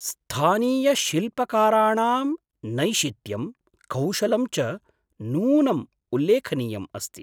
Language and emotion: Sanskrit, surprised